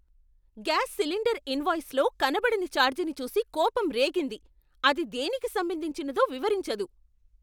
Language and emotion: Telugu, angry